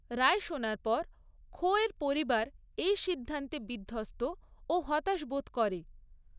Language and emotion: Bengali, neutral